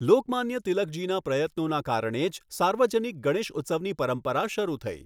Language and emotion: Gujarati, neutral